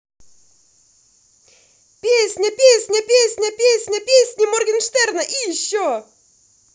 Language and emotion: Russian, positive